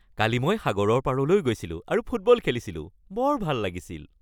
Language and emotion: Assamese, happy